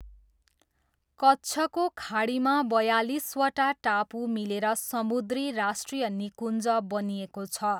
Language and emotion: Nepali, neutral